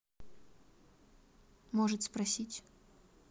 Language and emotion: Russian, neutral